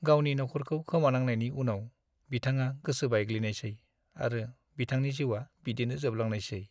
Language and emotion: Bodo, sad